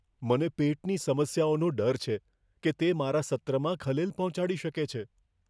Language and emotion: Gujarati, fearful